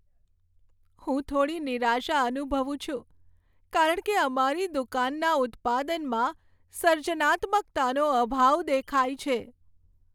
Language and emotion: Gujarati, sad